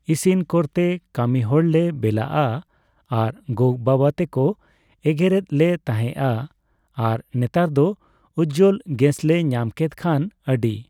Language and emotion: Santali, neutral